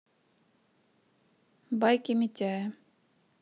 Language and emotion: Russian, neutral